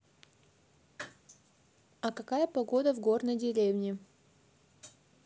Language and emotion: Russian, neutral